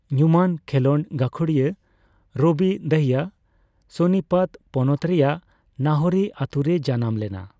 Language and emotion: Santali, neutral